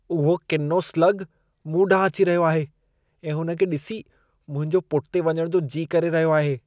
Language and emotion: Sindhi, disgusted